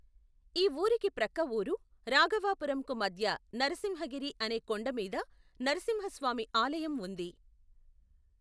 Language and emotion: Telugu, neutral